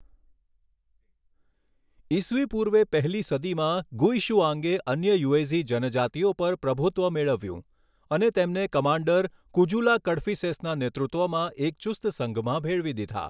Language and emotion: Gujarati, neutral